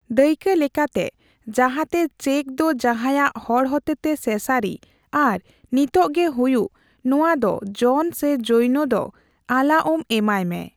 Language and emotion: Santali, neutral